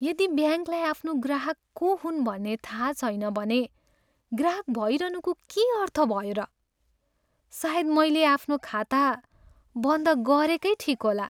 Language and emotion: Nepali, sad